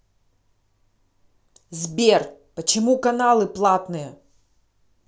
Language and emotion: Russian, angry